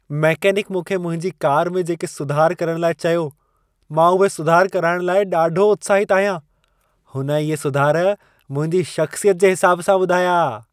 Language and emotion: Sindhi, happy